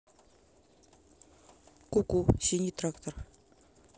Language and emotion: Russian, neutral